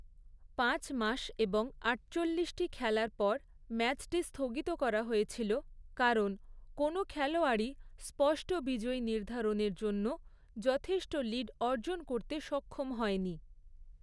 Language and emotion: Bengali, neutral